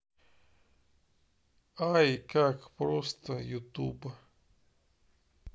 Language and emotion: Russian, neutral